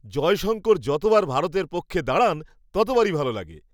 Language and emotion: Bengali, happy